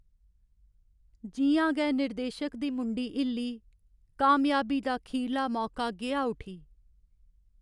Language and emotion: Dogri, sad